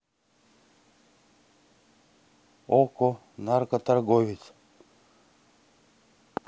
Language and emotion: Russian, neutral